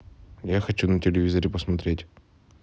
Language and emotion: Russian, neutral